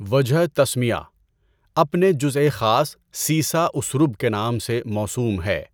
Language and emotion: Urdu, neutral